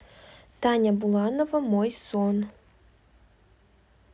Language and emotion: Russian, neutral